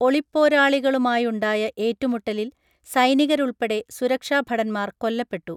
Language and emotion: Malayalam, neutral